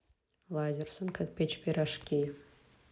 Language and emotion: Russian, neutral